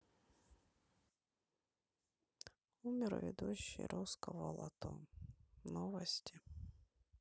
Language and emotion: Russian, sad